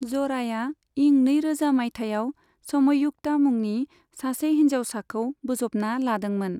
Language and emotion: Bodo, neutral